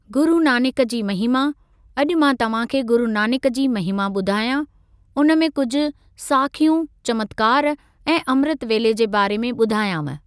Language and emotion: Sindhi, neutral